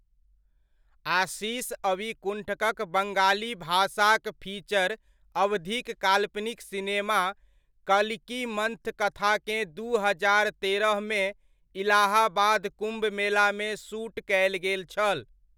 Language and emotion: Maithili, neutral